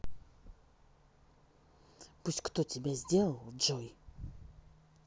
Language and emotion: Russian, angry